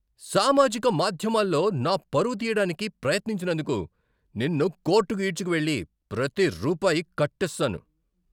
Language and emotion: Telugu, angry